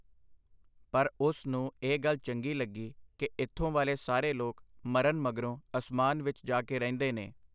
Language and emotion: Punjabi, neutral